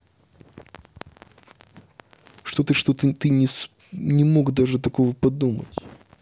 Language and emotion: Russian, neutral